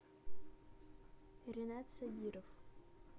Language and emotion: Russian, neutral